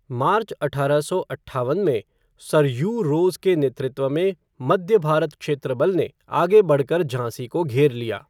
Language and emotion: Hindi, neutral